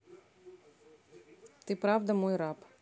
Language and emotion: Russian, neutral